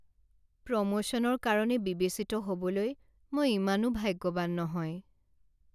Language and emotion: Assamese, sad